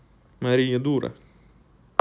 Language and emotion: Russian, neutral